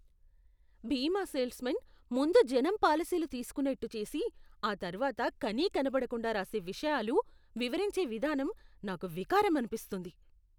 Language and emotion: Telugu, disgusted